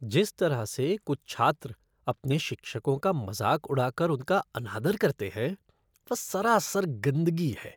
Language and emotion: Hindi, disgusted